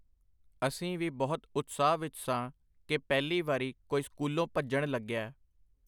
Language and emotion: Punjabi, neutral